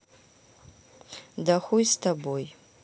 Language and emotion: Russian, neutral